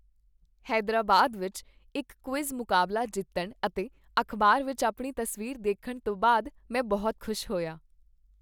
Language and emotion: Punjabi, happy